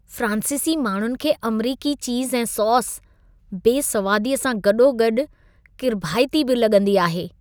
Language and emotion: Sindhi, disgusted